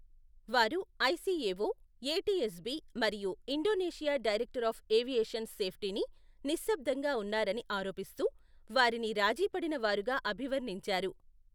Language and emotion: Telugu, neutral